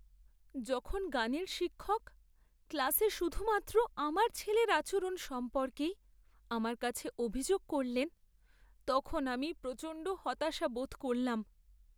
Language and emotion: Bengali, sad